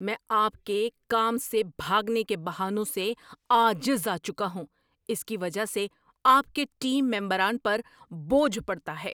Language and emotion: Urdu, angry